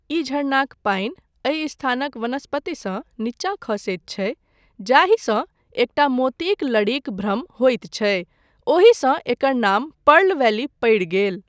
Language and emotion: Maithili, neutral